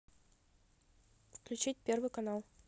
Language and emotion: Russian, neutral